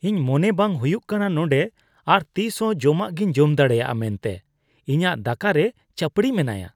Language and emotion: Santali, disgusted